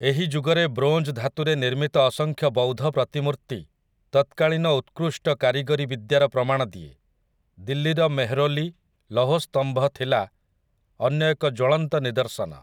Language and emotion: Odia, neutral